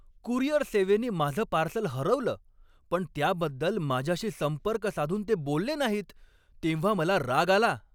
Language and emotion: Marathi, angry